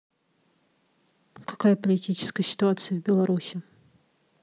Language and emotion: Russian, neutral